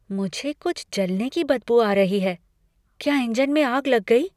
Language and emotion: Hindi, fearful